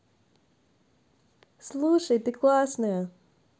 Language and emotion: Russian, positive